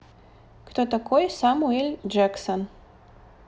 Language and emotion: Russian, neutral